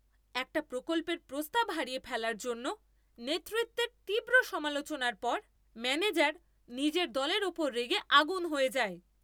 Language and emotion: Bengali, angry